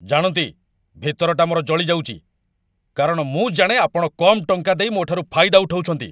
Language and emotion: Odia, angry